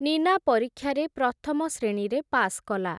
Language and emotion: Odia, neutral